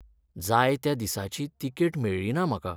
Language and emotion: Goan Konkani, sad